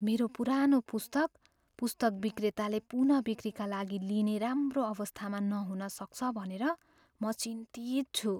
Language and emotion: Nepali, fearful